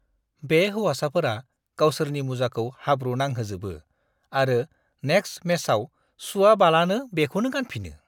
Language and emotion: Bodo, disgusted